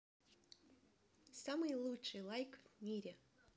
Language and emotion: Russian, positive